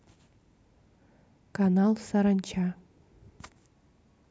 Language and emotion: Russian, neutral